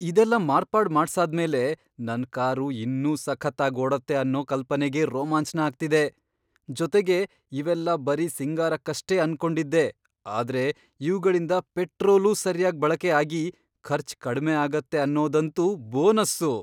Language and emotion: Kannada, surprised